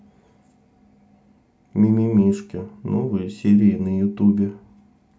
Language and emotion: Russian, neutral